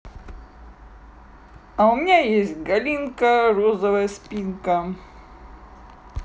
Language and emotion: Russian, positive